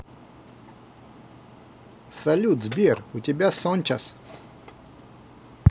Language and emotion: Russian, positive